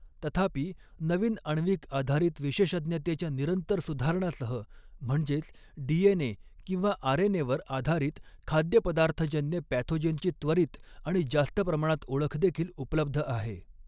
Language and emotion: Marathi, neutral